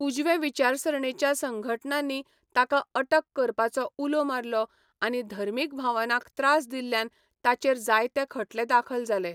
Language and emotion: Goan Konkani, neutral